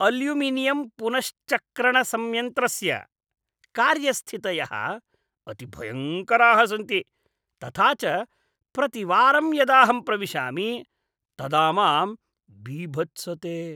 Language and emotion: Sanskrit, disgusted